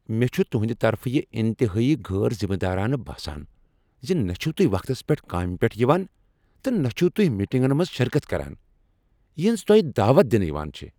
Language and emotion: Kashmiri, angry